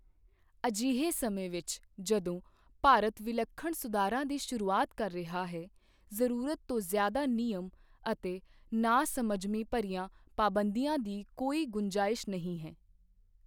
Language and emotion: Punjabi, neutral